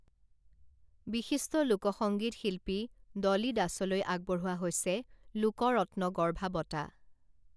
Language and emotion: Assamese, neutral